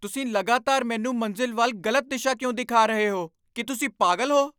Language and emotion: Punjabi, angry